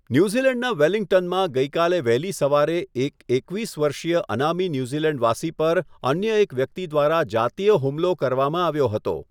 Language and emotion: Gujarati, neutral